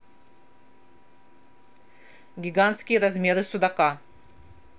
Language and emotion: Russian, neutral